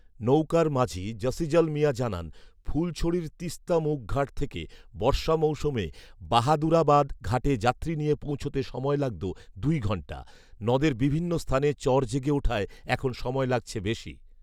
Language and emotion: Bengali, neutral